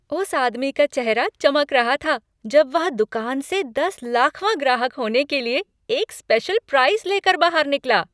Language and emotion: Hindi, happy